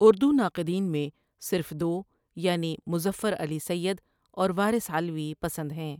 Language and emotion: Urdu, neutral